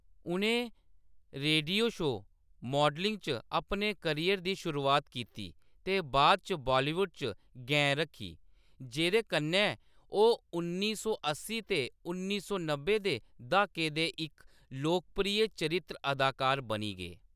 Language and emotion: Dogri, neutral